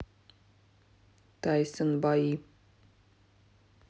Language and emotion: Russian, neutral